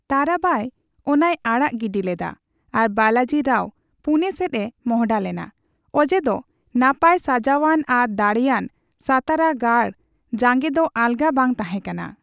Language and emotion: Santali, neutral